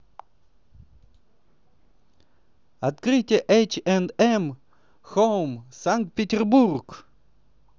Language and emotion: Russian, positive